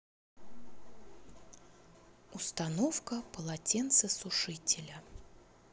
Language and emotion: Russian, neutral